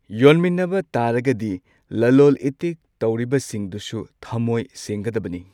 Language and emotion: Manipuri, neutral